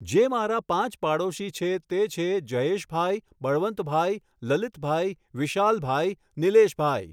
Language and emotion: Gujarati, neutral